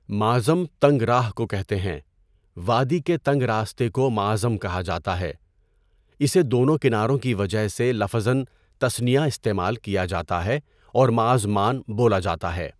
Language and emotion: Urdu, neutral